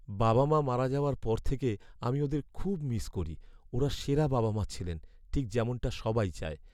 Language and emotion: Bengali, sad